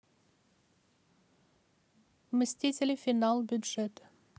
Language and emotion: Russian, neutral